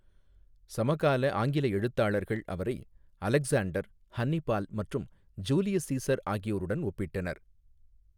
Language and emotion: Tamil, neutral